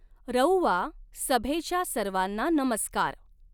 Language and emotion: Marathi, neutral